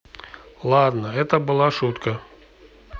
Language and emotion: Russian, neutral